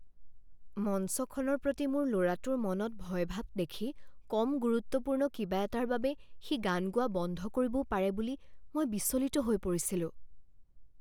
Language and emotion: Assamese, fearful